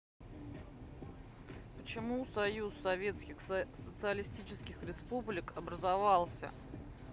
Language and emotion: Russian, neutral